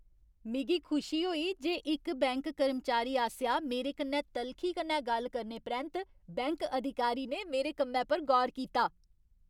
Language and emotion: Dogri, happy